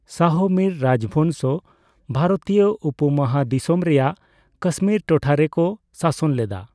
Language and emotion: Santali, neutral